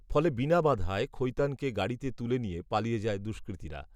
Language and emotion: Bengali, neutral